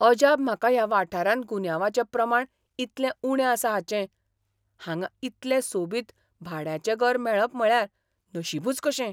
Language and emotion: Goan Konkani, surprised